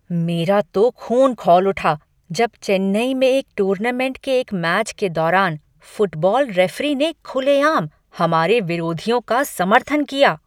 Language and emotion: Hindi, angry